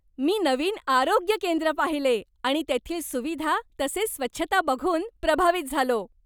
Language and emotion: Marathi, happy